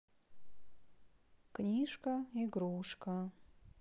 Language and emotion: Russian, sad